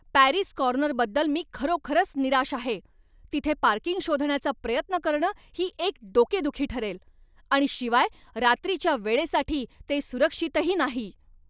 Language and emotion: Marathi, angry